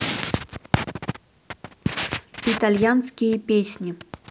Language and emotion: Russian, neutral